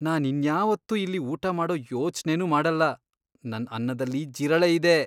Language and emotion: Kannada, disgusted